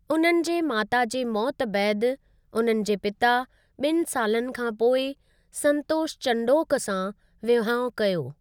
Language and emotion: Sindhi, neutral